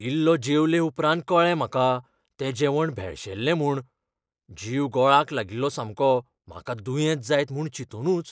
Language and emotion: Goan Konkani, fearful